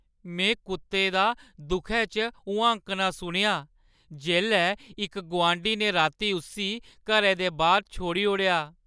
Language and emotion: Dogri, sad